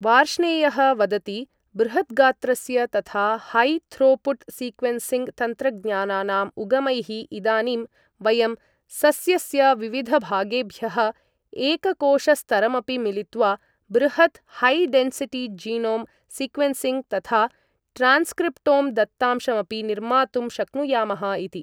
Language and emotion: Sanskrit, neutral